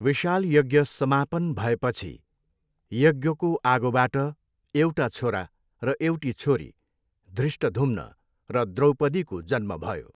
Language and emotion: Nepali, neutral